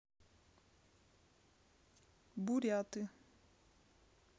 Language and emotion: Russian, neutral